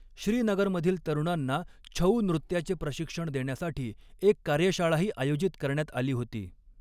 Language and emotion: Marathi, neutral